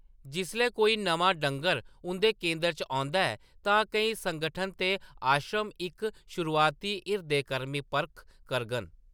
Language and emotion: Dogri, neutral